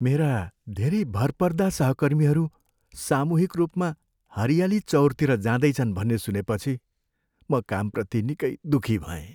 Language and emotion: Nepali, sad